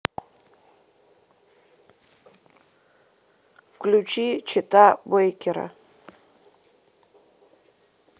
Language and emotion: Russian, neutral